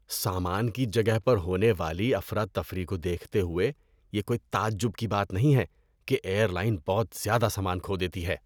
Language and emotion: Urdu, disgusted